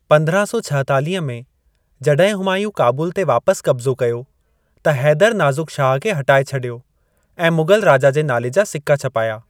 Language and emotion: Sindhi, neutral